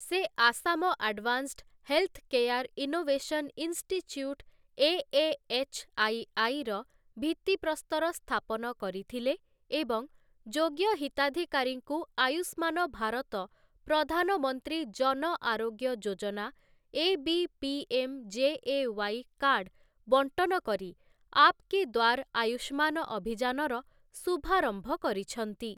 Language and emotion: Odia, neutral